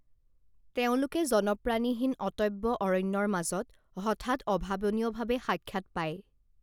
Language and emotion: Assamese, neutral